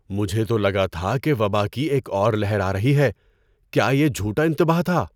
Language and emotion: Urdu, surprised